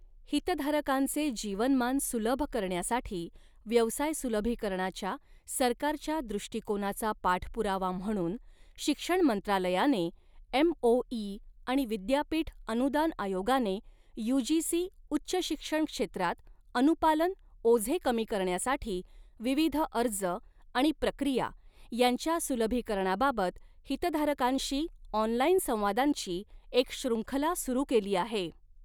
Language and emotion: Marathi, neutral